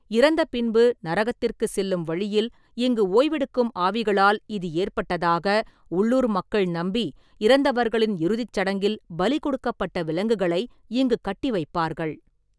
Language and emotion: Tamil, neutral